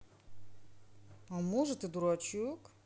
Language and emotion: Russian, positive